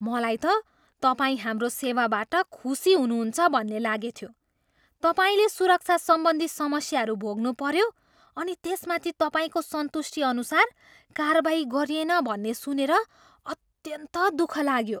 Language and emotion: Nepali, surprised